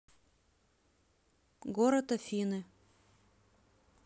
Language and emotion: Russian, neutral